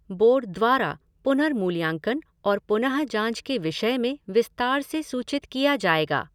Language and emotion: Hindi, neutral